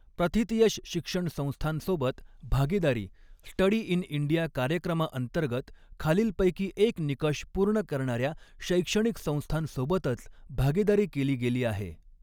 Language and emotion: Marathi, neutral